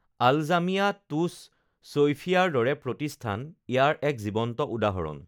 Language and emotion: Assamese, neutral